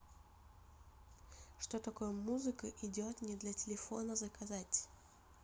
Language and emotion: Russian, neutral